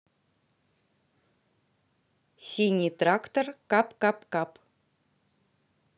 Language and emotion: Russian, neutral